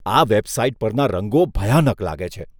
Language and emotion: Gujarati, disgusted